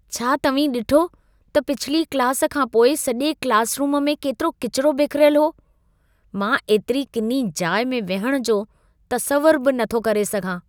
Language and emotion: Sindhi, disgusted